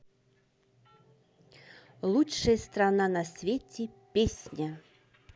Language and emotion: Russian, positive